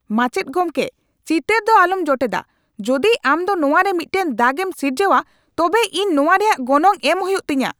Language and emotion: Santali, angry